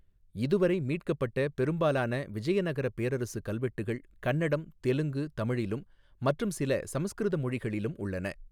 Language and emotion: Tamil, neutral